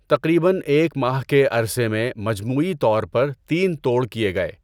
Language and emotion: Urdu, neutral